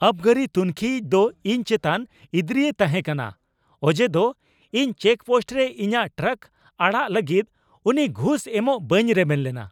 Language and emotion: Santali, angry